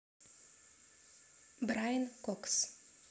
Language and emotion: Russian, neutral